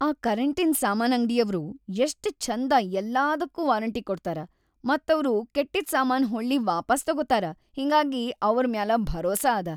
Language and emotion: Kannada, happy